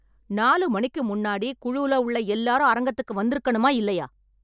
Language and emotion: Tamil, angry